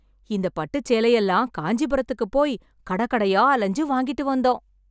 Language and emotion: Tamil, happy